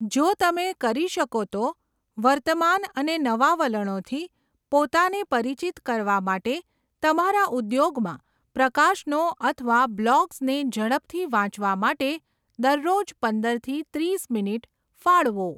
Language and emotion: Gujarati, neutral